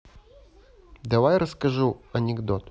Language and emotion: Russian, neutral